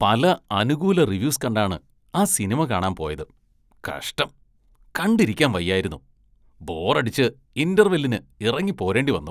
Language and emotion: Malayalam, disgusted